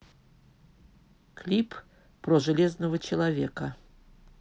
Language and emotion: Russian, neutral